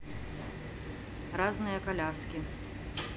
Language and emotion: Russian, neutral